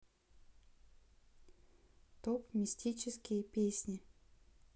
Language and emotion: Russian, neutral